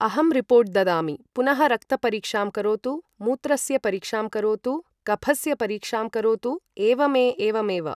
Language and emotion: Sanskrit, neutral